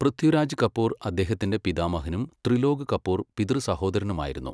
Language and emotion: Malayalam, neutral